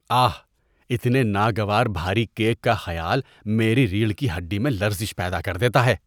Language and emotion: Urdu, disgusted